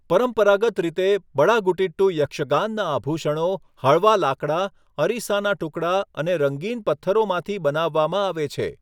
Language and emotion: Gujarati, neutral